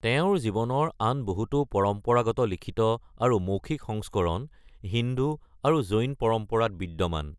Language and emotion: Assamese, neutral